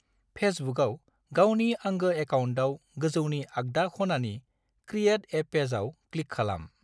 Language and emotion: Bodo, neutral